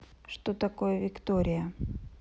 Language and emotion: Russian, neutral